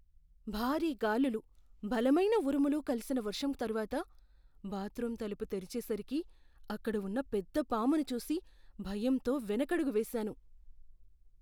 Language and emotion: Telugu, fearful